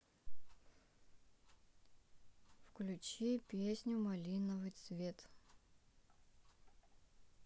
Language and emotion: Russian, neutral